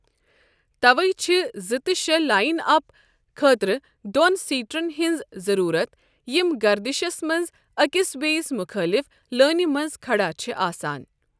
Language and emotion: Kashmiri, neutral